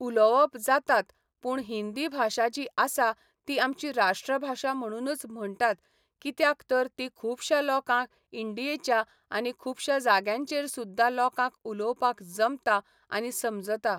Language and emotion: Goan Konkani, neutral